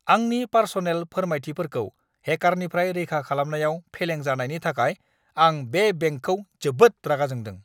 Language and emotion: Bodo, angry